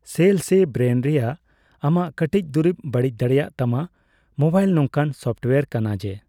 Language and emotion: Santali, neutral